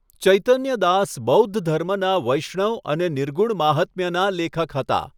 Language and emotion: Gujarati, neutral